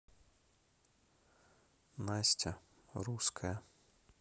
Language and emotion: Russian, neutral